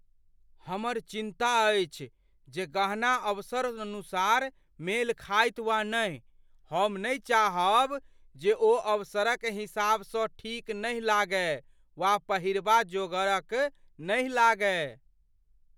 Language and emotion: Maithili, fearful